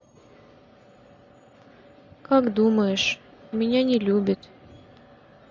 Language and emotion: Russian, sad